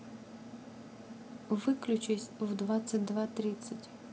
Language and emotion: Russian, neutral